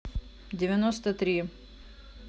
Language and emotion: Russian, neutral